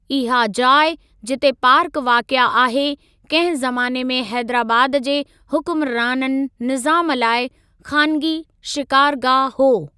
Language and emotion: Sindhi, neutral